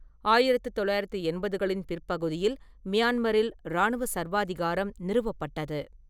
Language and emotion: Tamil, neutral